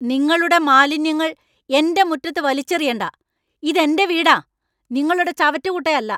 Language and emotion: Malayalam, angry